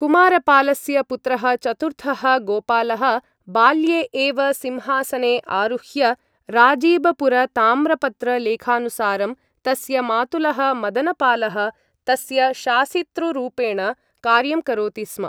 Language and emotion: Sanskrit, neutral